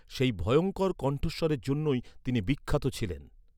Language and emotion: Bengali, neutral